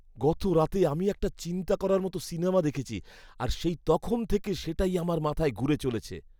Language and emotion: Bengali, fearful